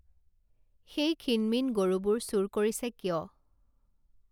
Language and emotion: Assamese, neutral